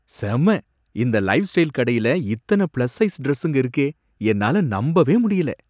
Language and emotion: Tamil, surprised